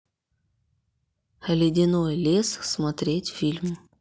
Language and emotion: Russian, neutral